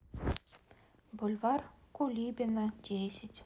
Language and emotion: Russian, neutral